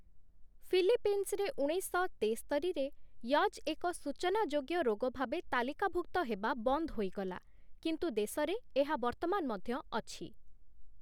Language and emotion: Odia, neutral